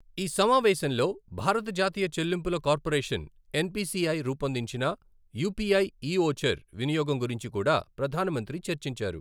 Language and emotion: Telugu, neutral